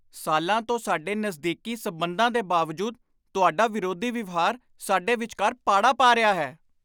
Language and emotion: Punjabi, angry